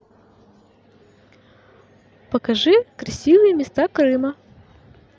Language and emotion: Russian, positive